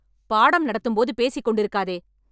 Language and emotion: Tamil, angry